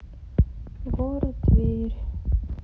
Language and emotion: Russian, sad